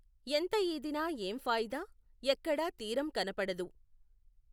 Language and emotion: Telugu, neutral